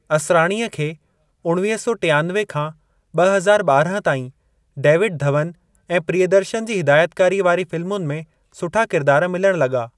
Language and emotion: Sindhi, neutral